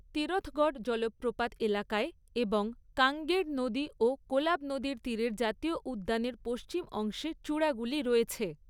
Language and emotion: Bengali, neutral